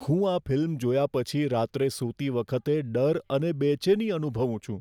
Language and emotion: Gujarati, fearful